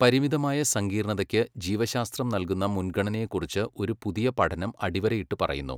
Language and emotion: Malayalam, neutral